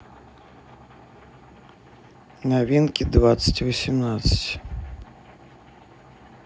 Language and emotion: Russian, neutral